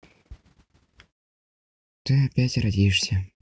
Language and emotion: Russian, sad